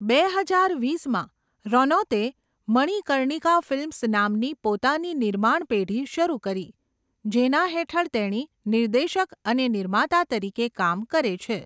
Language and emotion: Gujarati, neutral